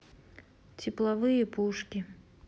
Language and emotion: Russian, neutral